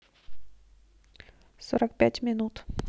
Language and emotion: Russian, neutral